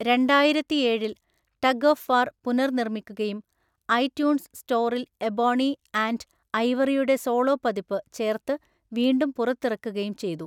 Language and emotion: Malayalam, neutral